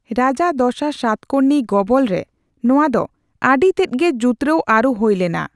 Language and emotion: Santali, neutral